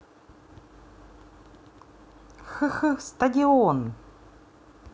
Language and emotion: Russian, positive